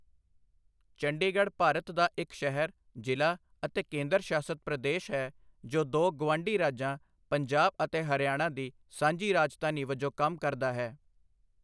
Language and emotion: Punjabi, neutral